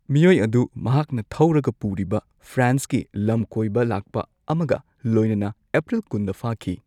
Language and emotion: Manipuri, neutral